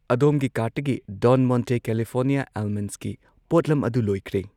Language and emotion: Manipuri, neutral